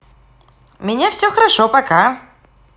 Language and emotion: Russian, positive